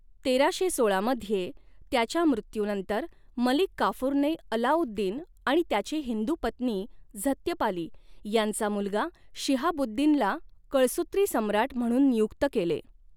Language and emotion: Marathi, neutral